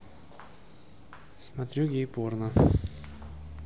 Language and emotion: Russian, neutral